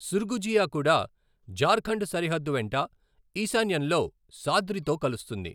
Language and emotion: Telugu, neutral